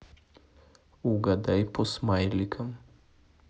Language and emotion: Russian, neutral